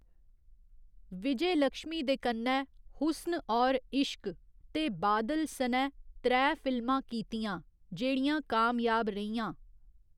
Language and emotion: Dogri, neutral